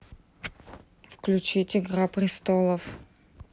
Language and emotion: Russian, neutral